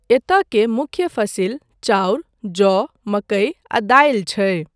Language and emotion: Maithili, neutral